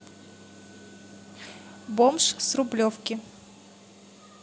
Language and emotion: Russian, neutral